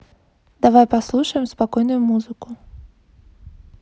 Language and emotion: Russian, neutral